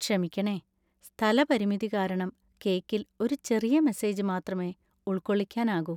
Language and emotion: Malayalam, sad